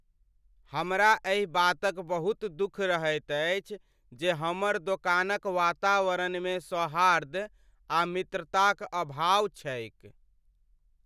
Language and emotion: Maithili, sad